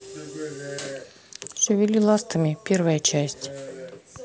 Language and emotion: Russian, neutral